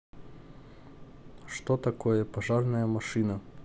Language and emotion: Russian, neutral